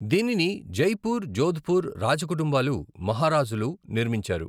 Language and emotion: Telugu, neutral